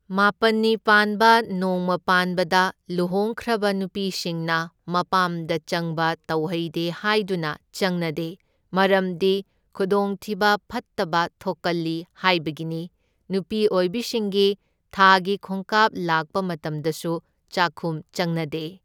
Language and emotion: Manipuri, neutral